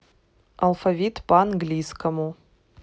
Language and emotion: Russian, neutral